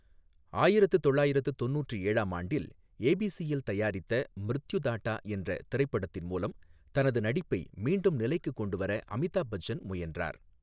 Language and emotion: Tamil, neutral